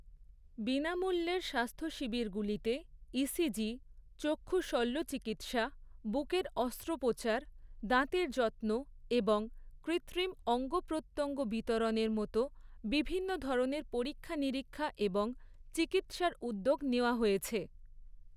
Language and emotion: Bengali, neutral